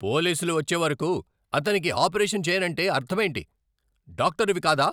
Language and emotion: Telugu, angry